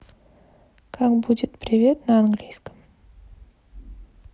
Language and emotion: Russian, neutral